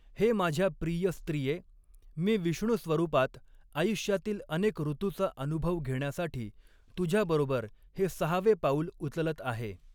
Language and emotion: Marathi, neutral